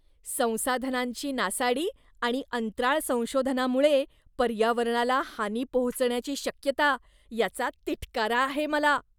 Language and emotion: Marathi, disgusted